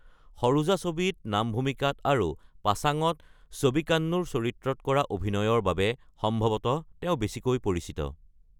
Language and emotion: Assamese, neutral